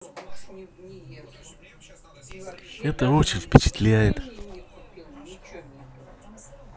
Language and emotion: Russian, positive